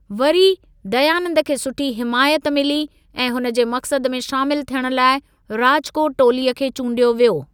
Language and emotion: Sindhi, neutral